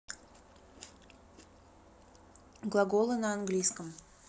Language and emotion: Russian, neutral